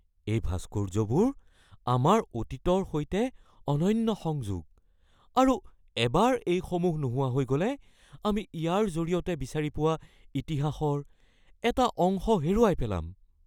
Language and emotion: Assamese, fearful